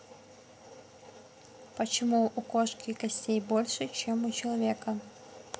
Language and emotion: Russian, neutral